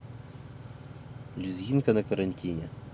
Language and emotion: Russian, neutral